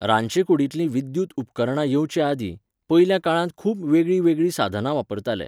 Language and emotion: Goan Konkani, neutral